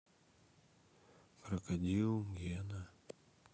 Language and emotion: Russian, sad